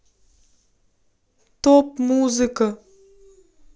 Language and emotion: Russian, neutral